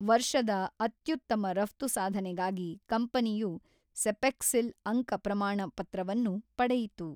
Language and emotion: Kannada, neutral